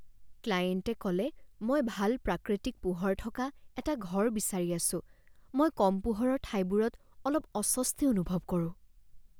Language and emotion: Assamese, fearful